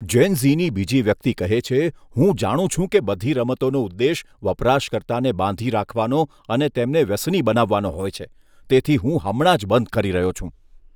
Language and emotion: Gujarati, disgusted